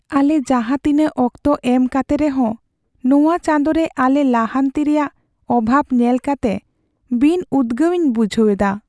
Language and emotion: Santali, sad